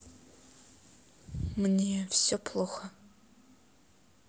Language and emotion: Russian, sad